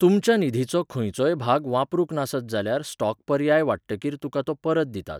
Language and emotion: Goan Konkani, neutral